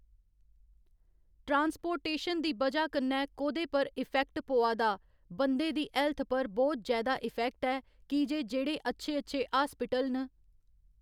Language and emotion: Dogri, neutral